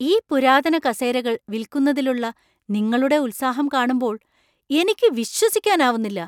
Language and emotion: Malayalam, surprised